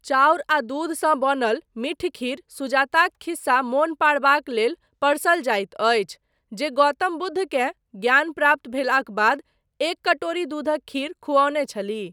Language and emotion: Maithili, neutral